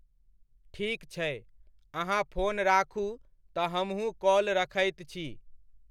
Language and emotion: Maithili, neutral